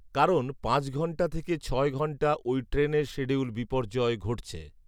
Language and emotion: Bengali, neutral